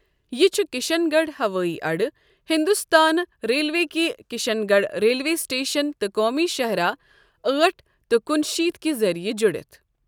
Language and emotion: Kashmiri, neutral